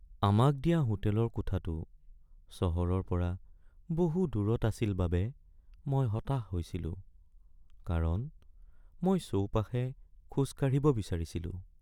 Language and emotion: Assamese, sad